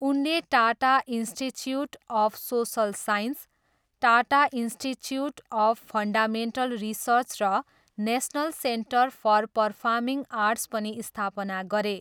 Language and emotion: Nepali, neutral